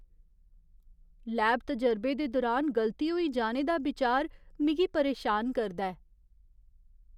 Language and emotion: Dogri, fearful